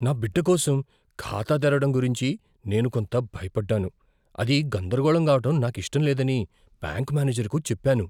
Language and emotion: Telugu, fearful